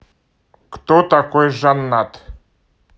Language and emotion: Russian, neutral